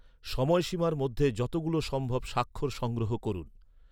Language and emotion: Bengali, neutral